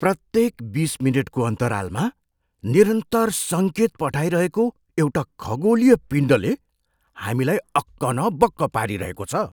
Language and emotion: Nepali, surprised